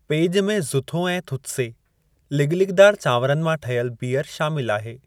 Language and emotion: Sindhi, neutral